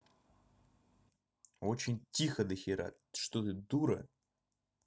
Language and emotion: Russian, angry